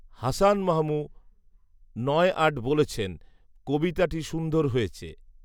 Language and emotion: Bengali, neutral